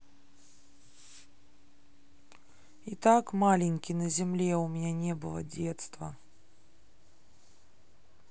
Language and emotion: Russian, sad